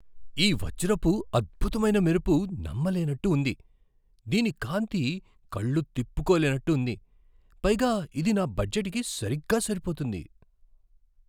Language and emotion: Telugu, surprised